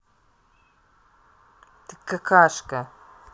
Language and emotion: Russian, angry